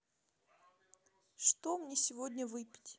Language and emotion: Russian, neutral